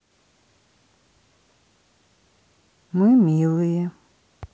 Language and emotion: Russian, neutral